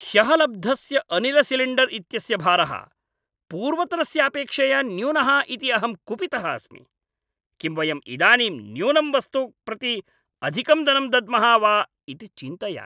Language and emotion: Sanskrit, angry